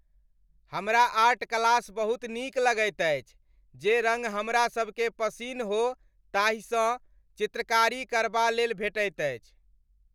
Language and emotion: Maithili, happy